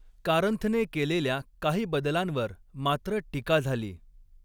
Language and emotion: Marathi, neutral